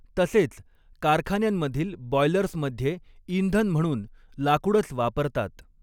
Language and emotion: Marathi, neutral